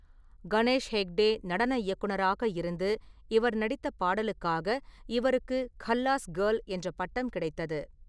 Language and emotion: Tamil, neutral